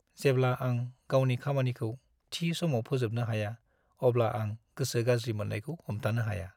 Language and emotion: Bodo, sad